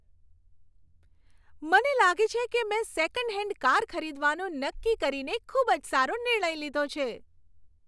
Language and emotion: Gujarati, happy